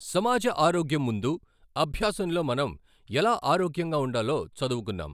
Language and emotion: Telugu, neutral